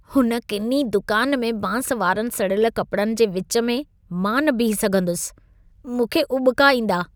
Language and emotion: Sindhi, disgusted